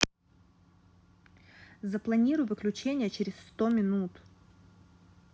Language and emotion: Russian, neutral